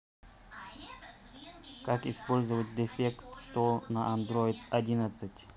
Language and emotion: Russian, neutral